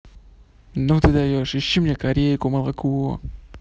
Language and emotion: Russian, neutral